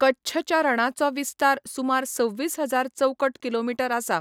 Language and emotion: Goan Konkani, neutral